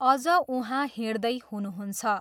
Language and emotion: Nepali, neutral